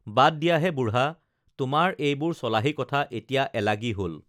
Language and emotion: Assamese, neutral